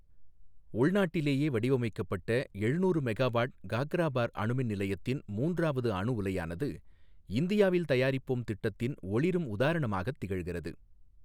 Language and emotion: Tamil, neutral